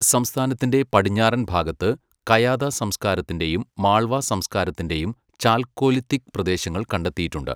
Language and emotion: Malayalam, neutral